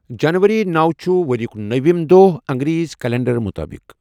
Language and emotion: Kashmiri, neutral